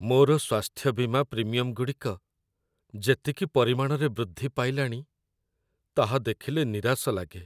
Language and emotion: Odia, sad